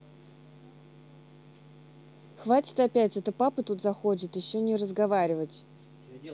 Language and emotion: Russian, angry